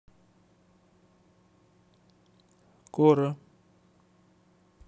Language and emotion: Russian, neutral